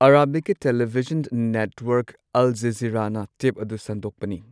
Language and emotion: Manipuri, neutral